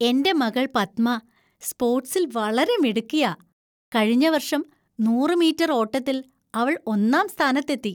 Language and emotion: Malayalam, happy